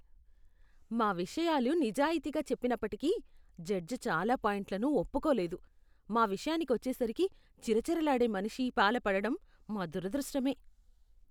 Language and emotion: Telugu, disgusted